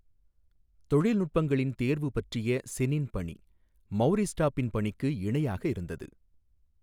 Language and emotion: Tamil, neutral